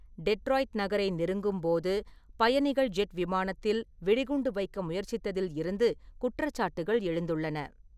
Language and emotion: Tamil, neutral